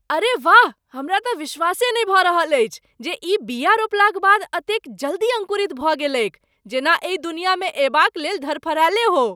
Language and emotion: Maithili, surprised